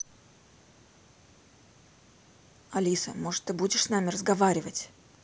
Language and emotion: Russian, angry